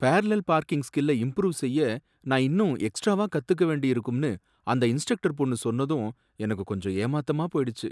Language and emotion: Tamil, sad